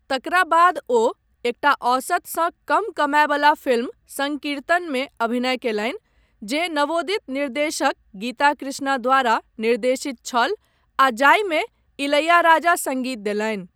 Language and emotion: Maithili, neutral